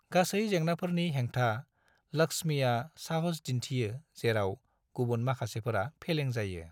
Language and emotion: Bodo, neutral